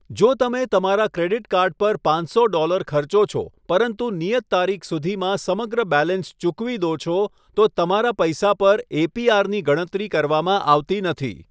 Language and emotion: Gujarati, neutral